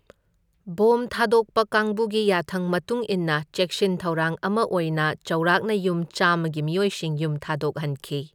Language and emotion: Manipuri, neutral